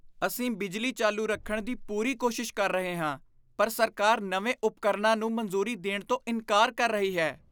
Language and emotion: Punjabi, disgusted